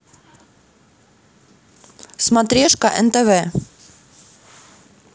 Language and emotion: Russian, neutral